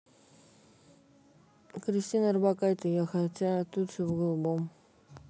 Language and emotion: Russian, neutral